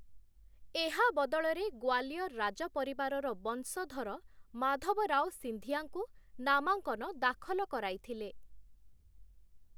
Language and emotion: Odia, neutral